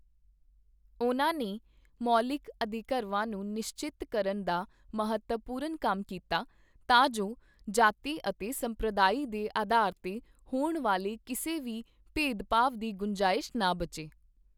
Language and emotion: Punjabi, neutral